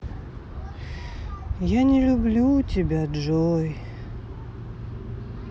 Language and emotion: Russian, sad